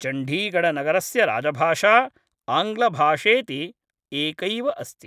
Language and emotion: Sanskrit, neutral